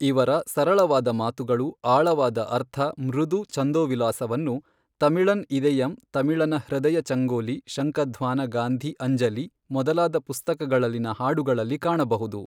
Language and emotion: Kannada, neutral